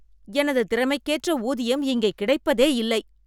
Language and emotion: Tamil, angry